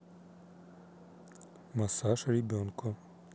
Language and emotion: Russian, neutral